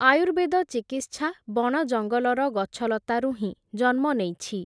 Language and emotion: Odia, neutral